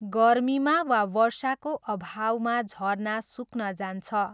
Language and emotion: Nepali, neutral